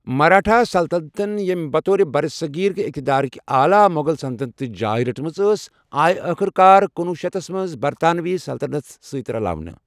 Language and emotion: Kashmiri, neutral